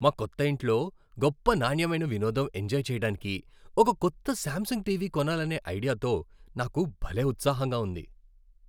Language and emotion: Telugu, happy